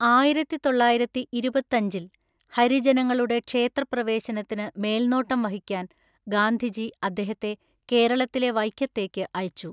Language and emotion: Malayalam, neutral